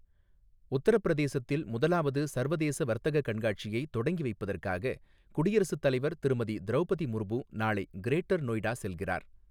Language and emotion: Tamil, neutral